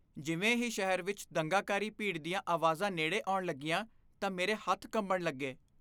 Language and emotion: Punjabi, fearful